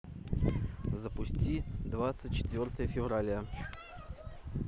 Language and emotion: Russian, neutral